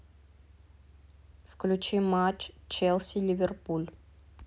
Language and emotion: Russian, neutral